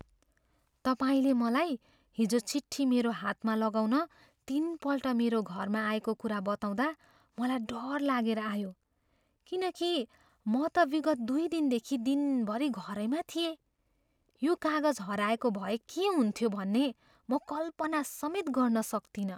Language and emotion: Nepali, fearful